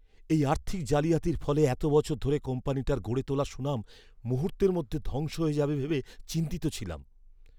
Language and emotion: Bengali, fearful